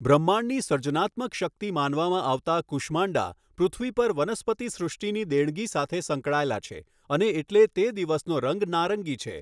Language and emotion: Gujarati, neutral